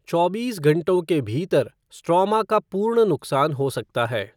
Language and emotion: Hindi, neutral